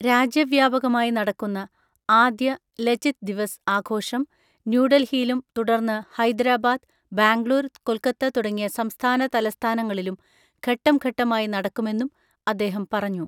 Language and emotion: Malayalam, neutral